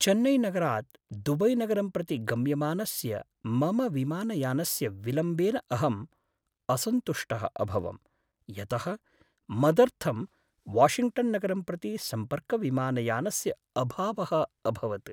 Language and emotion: Sanskrit, sad